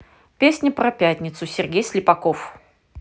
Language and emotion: Russian, neutral